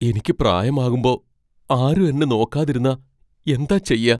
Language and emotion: Malayalam, fearful